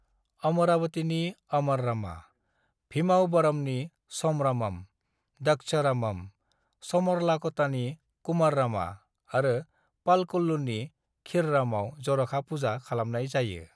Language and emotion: Bodo, neutral